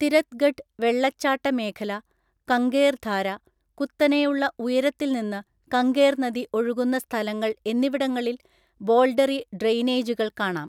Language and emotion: Malayalam, neutral